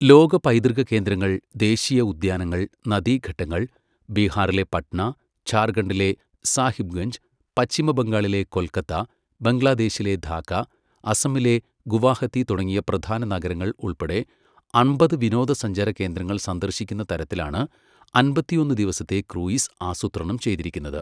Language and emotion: Malayalam, neutral